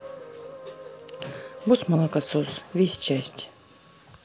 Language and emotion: Russian, neutral